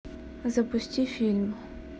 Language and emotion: Russian, neutral